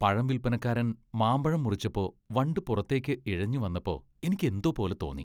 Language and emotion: Malayalam, disgusted